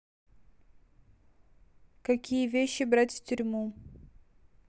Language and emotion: Russian, neutral